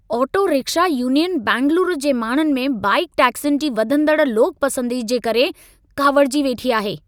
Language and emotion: Sindhi, angry